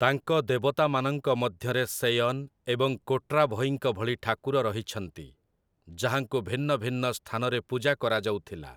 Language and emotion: Odia, neutral